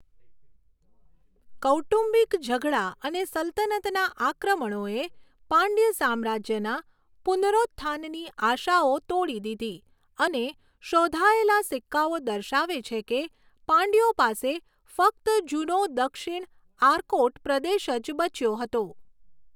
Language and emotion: Gujarati, neutral